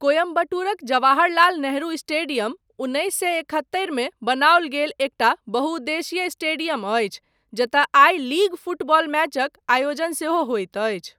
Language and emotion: Maithili, neutral